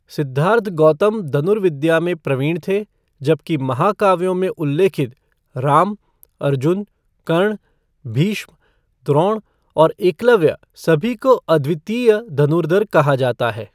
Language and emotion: Hindi, neutral